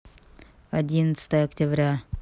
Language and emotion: Russian, neutral